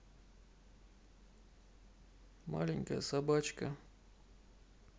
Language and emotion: Russian, neutral